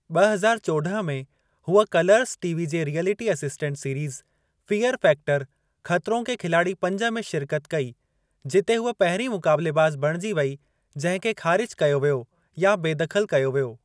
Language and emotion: Sindhi, neutral